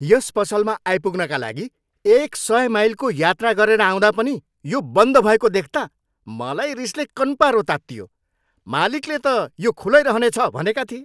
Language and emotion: Nepali, angry